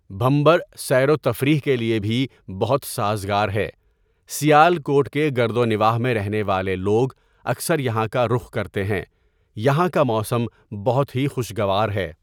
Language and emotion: Urdu, neutral